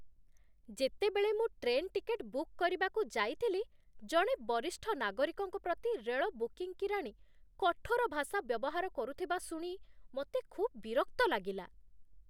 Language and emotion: Odia, disgusted